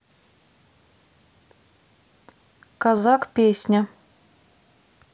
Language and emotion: Russian, neutral